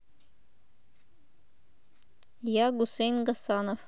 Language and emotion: Russian, neutral